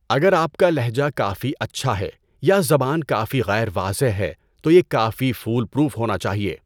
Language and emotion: Urdu, neutral